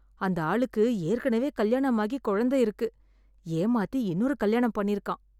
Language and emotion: Tamil, disgusted